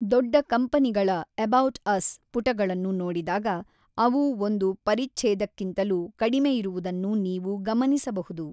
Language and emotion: Kannada, neutral